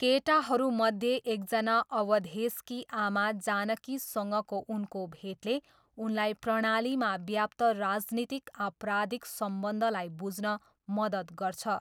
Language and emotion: Nepali, neutral